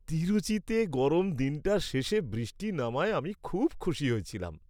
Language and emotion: Bengali, happy